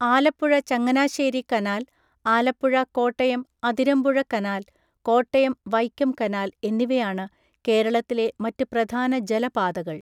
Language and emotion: Malayalam, neutral